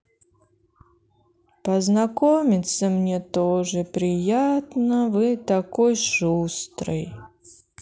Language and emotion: Russian, sad